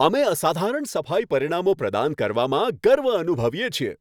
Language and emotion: Gujarati, happy